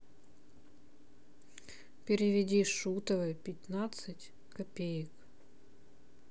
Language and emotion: Russian, neutral